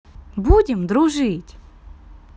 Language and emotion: Russian, positive